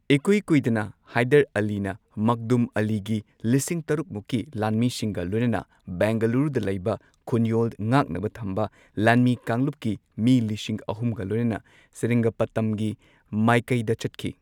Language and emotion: Manipuri, neutral